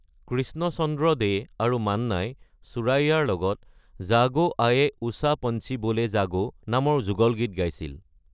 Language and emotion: Assamese, neutral